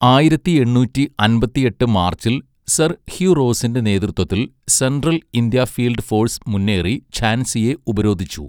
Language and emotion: Malayalam, neutral